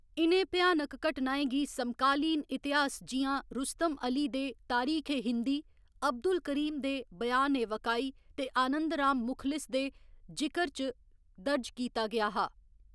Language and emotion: Dogri, neutral